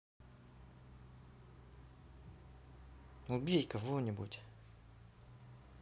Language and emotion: Russian, angry